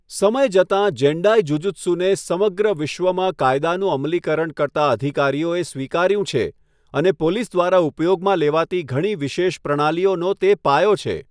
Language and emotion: Gujarati, neutral